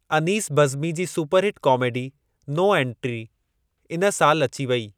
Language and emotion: Sindhi, neutral